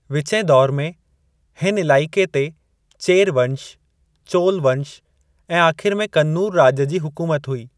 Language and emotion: Sindhi, neutral